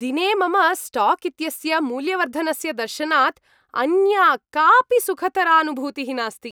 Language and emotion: Sanskrit, happy